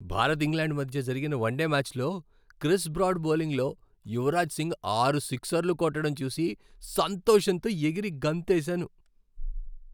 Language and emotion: Telugu, happy